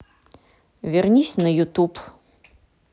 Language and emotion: Russian, neutral